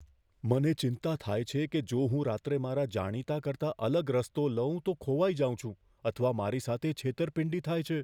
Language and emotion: Gujarati, fearful